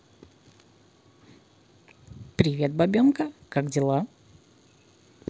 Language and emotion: Russian, positive